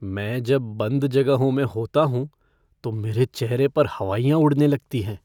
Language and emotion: Hindi, fearful